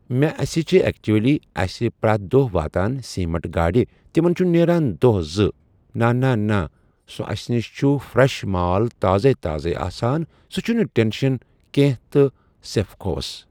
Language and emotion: Kashmiri, neutral